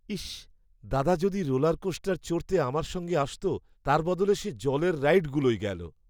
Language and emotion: Bengali, sad